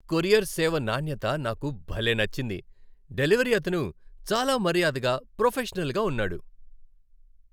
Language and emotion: Telugu, happy